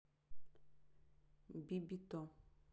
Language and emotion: Russian, neutral